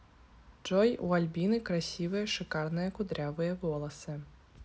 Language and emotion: Russian, neutral